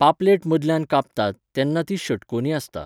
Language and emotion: Goan Konkani, neutral